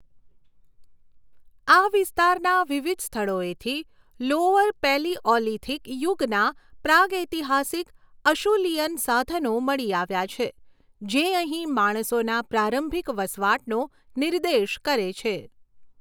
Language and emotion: Gujarati, neutral